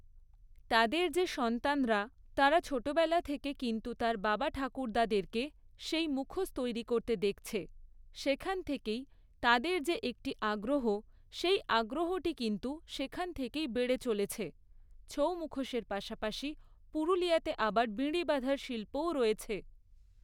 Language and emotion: Bengali, neutral